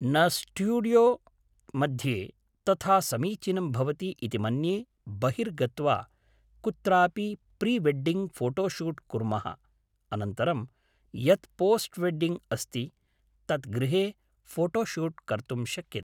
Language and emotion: Sanskrit, neutral